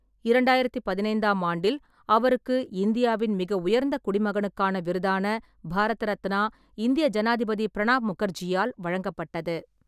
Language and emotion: Tamil, neutral